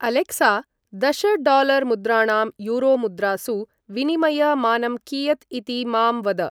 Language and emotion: Sanskrit, neutral